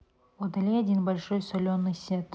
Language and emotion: Russian, neutral